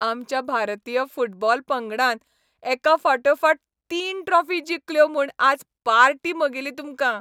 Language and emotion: Goan Konkani, happy